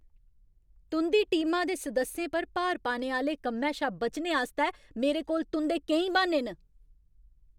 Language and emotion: Dogri, angry